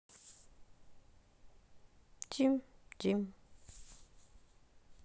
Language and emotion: Russian, sad